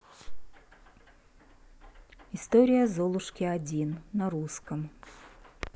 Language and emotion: Russian, neutral